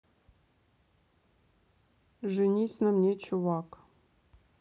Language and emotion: Russian, neutral